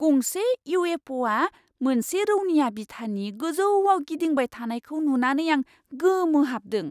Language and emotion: Bodo, surprised